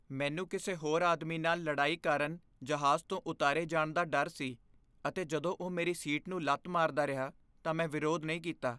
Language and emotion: Punjabi, fearful